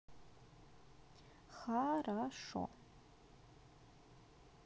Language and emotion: Russian, neutral